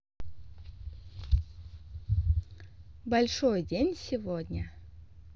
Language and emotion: Russian, neutral